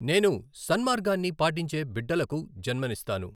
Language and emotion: Telugu, neutral